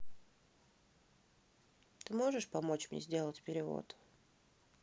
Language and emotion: Russian, neutral